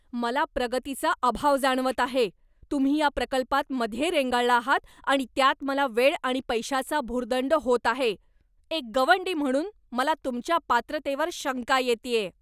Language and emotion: Marathi, angry